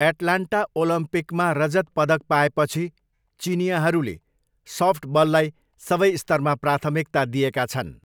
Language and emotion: Nepali, neutral